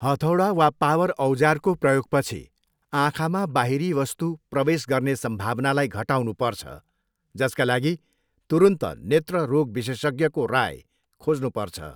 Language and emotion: Nepali, neutral